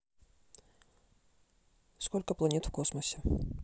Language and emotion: Russian, neutral